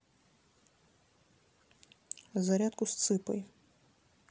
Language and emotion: Russian, neutral